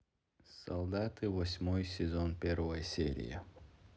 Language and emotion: Russian, neutral